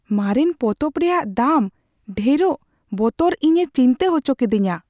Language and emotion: Santali, fearful